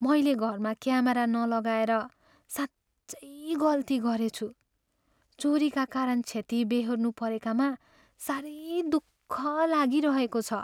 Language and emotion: Nepali, sad